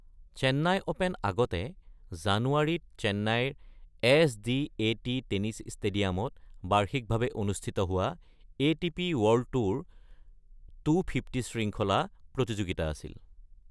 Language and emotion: Assamese, neutral